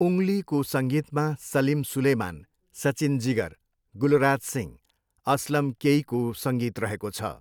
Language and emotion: Nepali, neutral